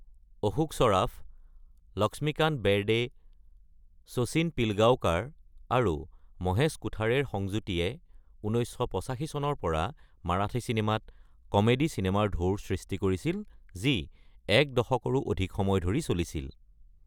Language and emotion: Assamese, neutral